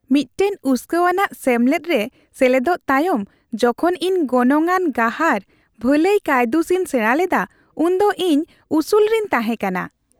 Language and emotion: Santali, happy